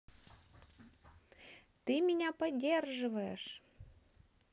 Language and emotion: Russian, positive